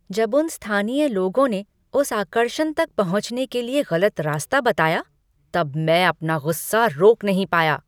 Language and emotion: Hindi, angry